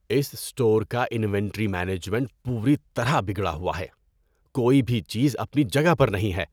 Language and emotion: Urdu, disgusted